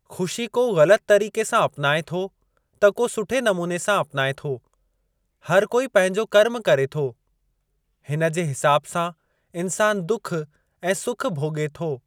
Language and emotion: Sindhi, neutral